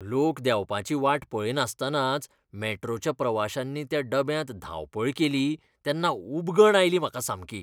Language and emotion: Goan Konkani, disgusted